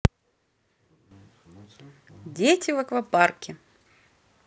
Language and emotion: Russian, positive